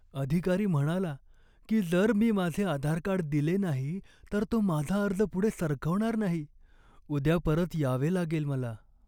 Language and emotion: Marathi, sad